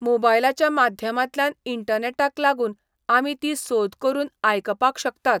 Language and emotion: Goan Konkani, neutral